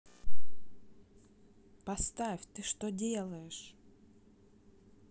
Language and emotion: Russian, angry